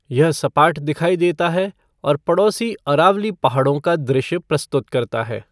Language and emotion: Hindi, neutral